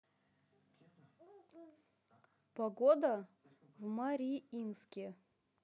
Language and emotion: Russian, neutral